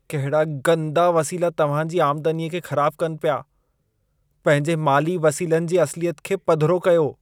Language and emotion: Sindhi, disgusted